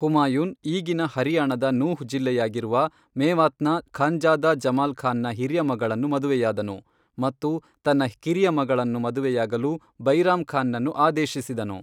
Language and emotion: Kannada, neutral